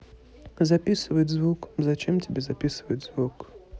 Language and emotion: Russian, neutral